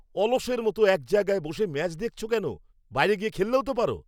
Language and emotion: Bengali, angry